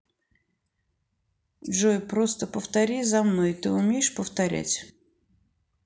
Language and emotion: Russian, neutral